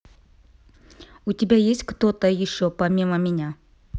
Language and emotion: Russian, neutral